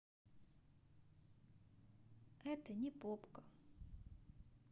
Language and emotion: Russian, neutral